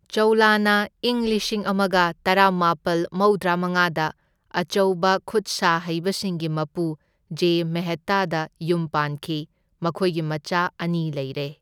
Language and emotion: Manipuri, neutral